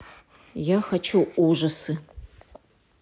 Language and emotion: Russian, neutral